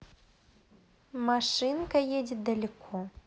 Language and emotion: Russian, neutral